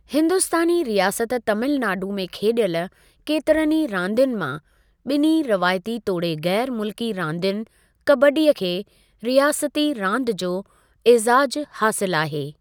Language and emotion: Sindhi, neutral